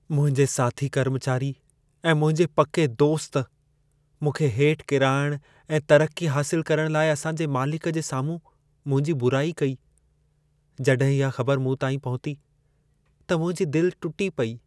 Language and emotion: Sindhi, sad